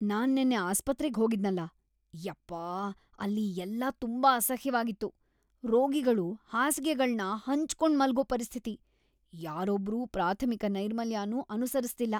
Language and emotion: Kannada, disgusted